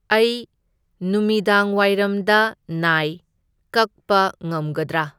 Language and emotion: Manipuri, neutral